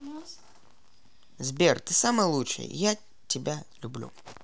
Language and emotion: Russian, positive